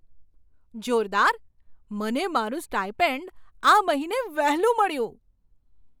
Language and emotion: Gujarati, surprised